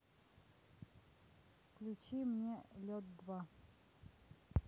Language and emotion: Russian, neutral